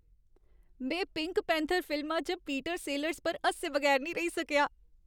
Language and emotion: Dogri, happy